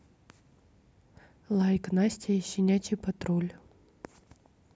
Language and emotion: Russian, neutral